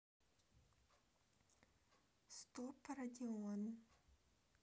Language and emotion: Russian, neutral